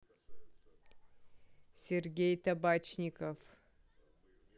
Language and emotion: Russian, neutral